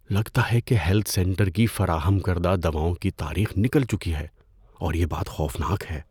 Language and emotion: Urdu, fearful